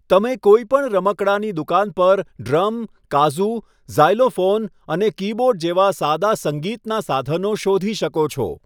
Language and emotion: Gujarati, neutral